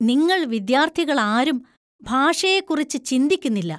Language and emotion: Malayalam, disgusted